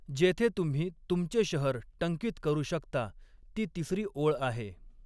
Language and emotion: Marathi, neutral